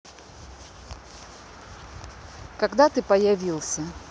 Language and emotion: Russian, neutral